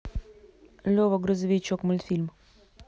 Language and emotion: Russian, neutral